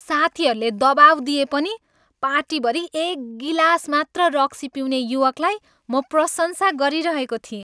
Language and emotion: Nepali, happy